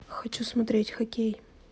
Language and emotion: Russian, neutral